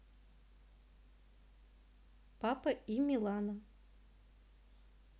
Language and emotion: Russian, neutral